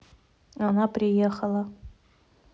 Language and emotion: Russian, neutral